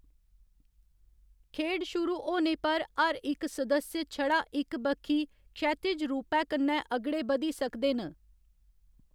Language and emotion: Dogri, neutral